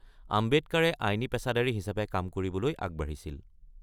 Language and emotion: Assamese, neutral